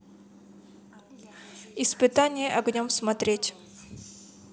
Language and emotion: Russian, neutral